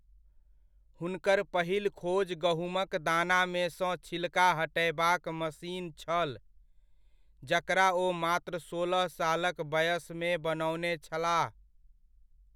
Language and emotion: Maithili, neutral